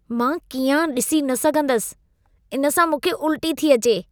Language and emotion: Sindhi, disgusted